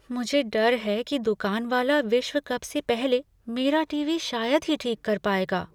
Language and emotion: Hindi, fearful